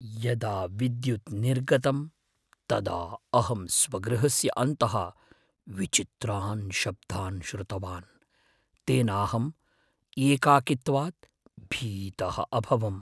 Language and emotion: Sanskrit, fearful